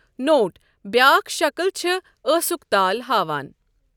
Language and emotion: Kashmiri, neutral